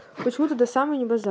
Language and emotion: Russian, neutral